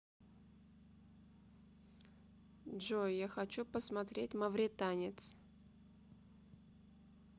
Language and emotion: Russian, neutral